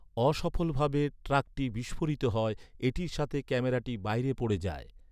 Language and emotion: Bengali, neutral